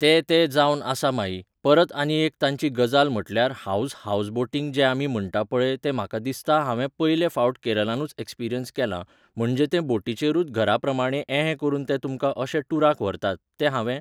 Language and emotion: Goan Konkani, neutral